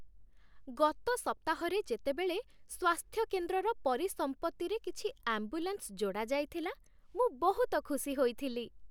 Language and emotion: Odia, happy